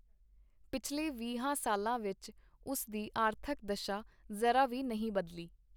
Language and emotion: Punjabi, neutral